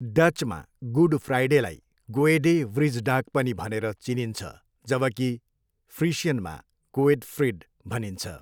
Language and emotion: Nepali, neutral